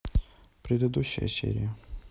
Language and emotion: Russian, neutral